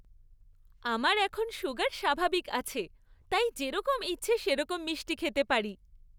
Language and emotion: Bengali, happy